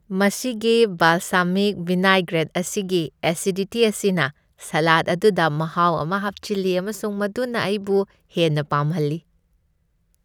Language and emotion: Manipuri, happy